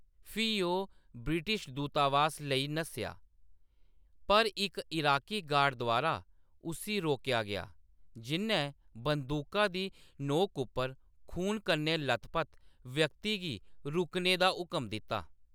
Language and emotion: Dogri, neutral